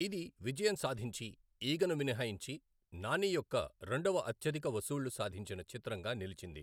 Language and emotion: Telugu, neutral